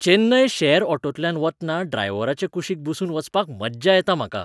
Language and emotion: Goan Konkani, happy